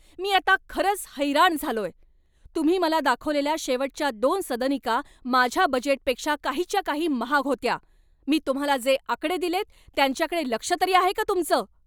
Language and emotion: Marathi, angry